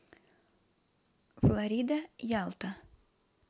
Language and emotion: Russian, neutral